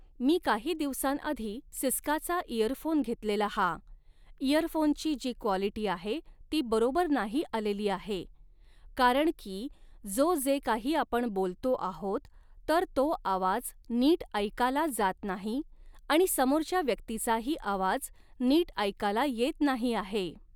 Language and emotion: Marathi, neutral